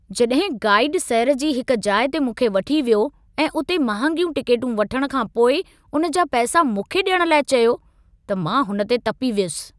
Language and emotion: Sindhi, angry